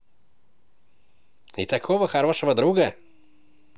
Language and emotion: Russian, positive